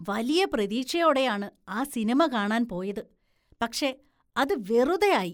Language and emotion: Malayalam, disgusted